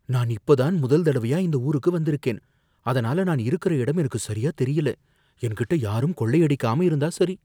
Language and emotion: Tamil, fearful